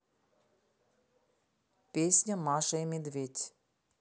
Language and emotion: Russian, neutral